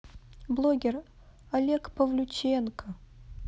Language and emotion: Russian, sad